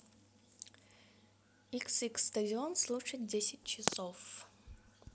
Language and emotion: Russian, neutral